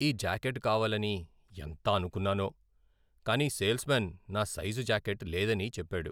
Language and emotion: Telugu, sad